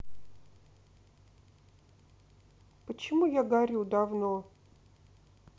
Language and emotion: Russian, sad